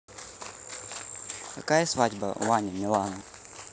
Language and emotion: Russian, neutral